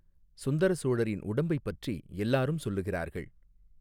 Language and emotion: Tamil, neutral